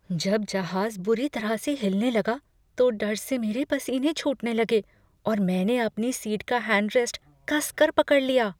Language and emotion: Hindi, fearful